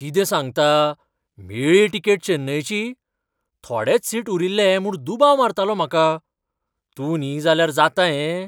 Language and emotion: Goan Konkani, surprised